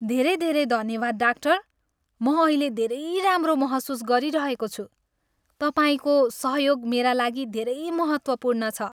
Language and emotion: Nepali, happy